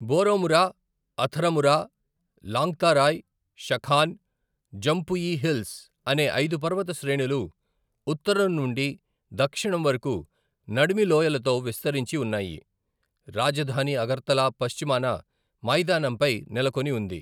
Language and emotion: Telugu, neutral